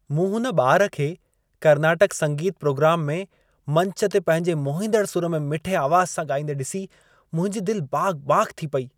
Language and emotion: Sindhi, happy